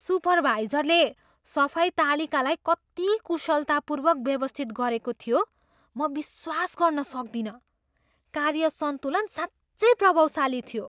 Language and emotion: Nepali, surprised